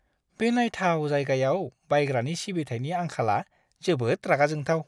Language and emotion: Bodo, disgusted